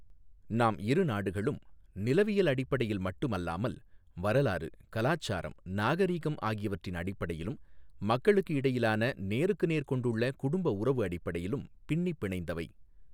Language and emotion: Tamil, neutral